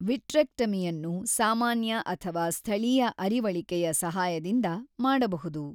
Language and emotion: Kannada, neutral